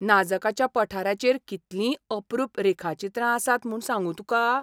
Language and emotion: Goan Konkani, surprised